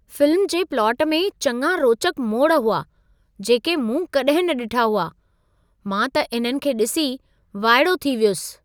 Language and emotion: Sindhi, surprised